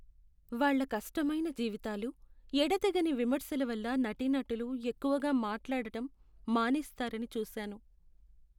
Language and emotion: Telugu, sad